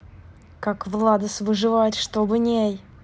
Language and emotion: Russian, angry